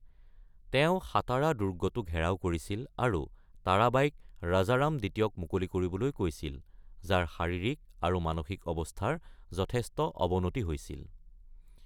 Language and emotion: Assamese, neutral